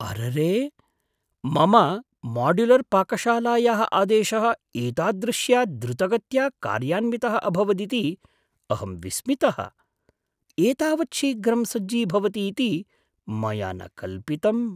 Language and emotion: Sanskrit, surprised